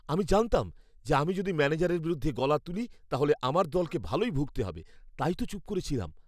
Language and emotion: Bengali, fearful